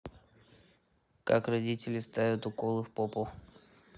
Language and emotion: Russian, neutral